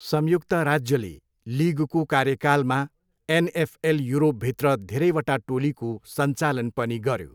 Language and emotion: Nepali, neutral